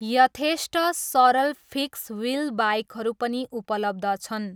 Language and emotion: Nepali, neutral